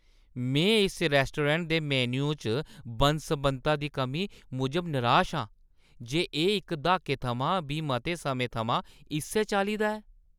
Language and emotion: Dogri, disgusted